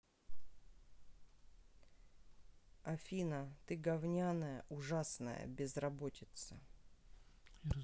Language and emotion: Russian, angry